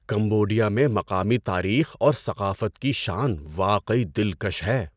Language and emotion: Urdu, surprised